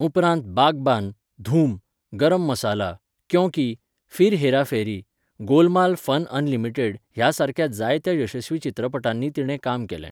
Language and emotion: Goan Konkani, neutral